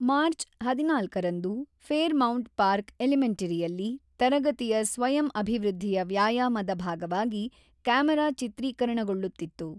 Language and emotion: Kannada, neutral